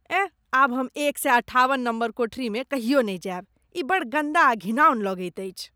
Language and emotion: Maithili, disgusted